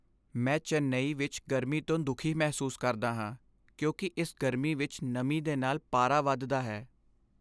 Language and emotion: Punjabi, sad